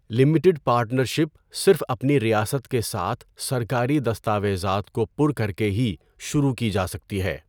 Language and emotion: Urdu, neutral